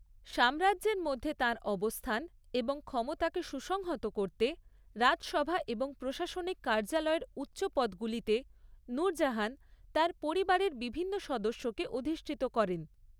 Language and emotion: Bengali, neutral